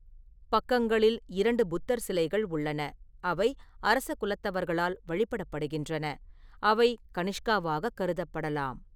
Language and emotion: Tamil, neutral